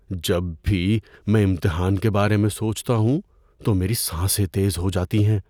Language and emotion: Urdu, fearful